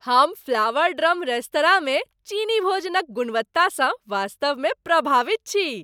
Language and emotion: Maithili, happy